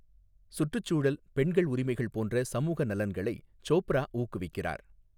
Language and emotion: Tamil, neutral